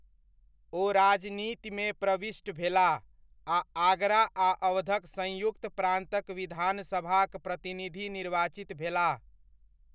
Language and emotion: Maithili, neutral